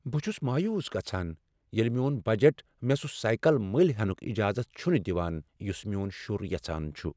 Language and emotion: Kashmiri, sad